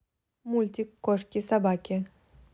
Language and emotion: Russian, positive